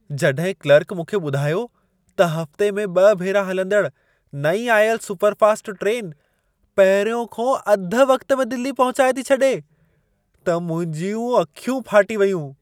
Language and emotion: Sindhi, surprised